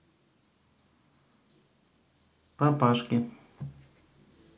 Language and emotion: Russian, neutral